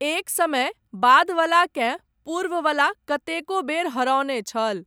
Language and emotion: Maithili, neutral